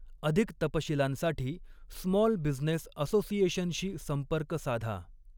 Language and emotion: Marathi, neutral